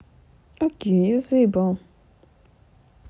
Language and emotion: Russian, neutral